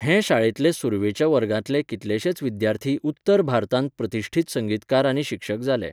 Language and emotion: Goan Konkani, neutral